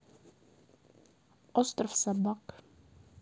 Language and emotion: Russian, neutral